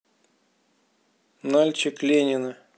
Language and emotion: Russian, neutral